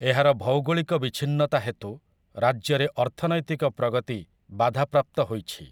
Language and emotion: Odia, neutral